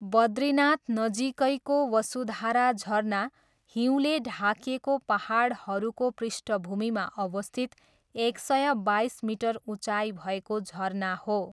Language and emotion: Nepali, neutral